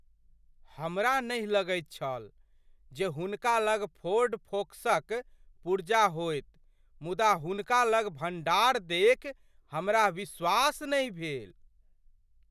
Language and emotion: Maithili, surprised